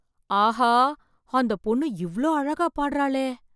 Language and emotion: Tamil, surprised